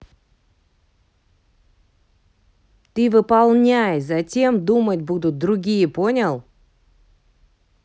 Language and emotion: Russian, angry